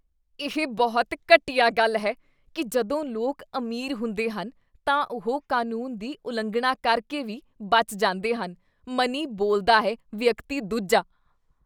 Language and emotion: Punjabi, disgusted